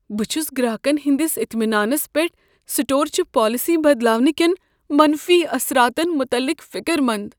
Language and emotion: Kashmiri, fearful